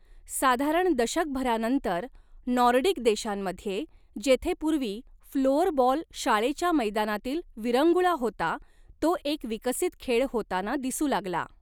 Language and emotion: Marathi, neutral